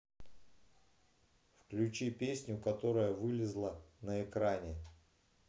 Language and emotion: Russian, neutral